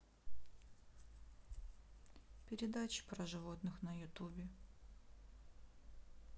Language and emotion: Russian, neutral